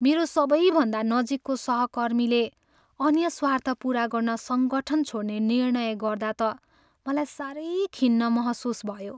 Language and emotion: Nepali, sad